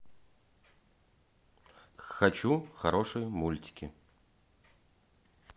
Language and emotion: Russian, neutral